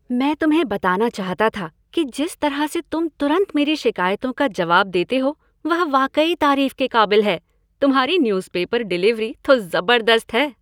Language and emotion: Hindi, happy